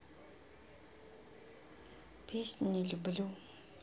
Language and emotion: Russian, neutral